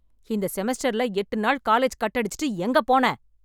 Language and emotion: Tamil, angry